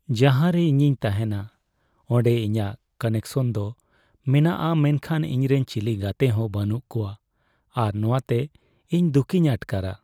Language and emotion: Santali, sad